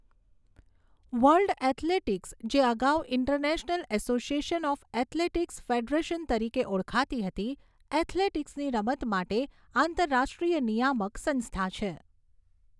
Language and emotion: Gujarati, neutral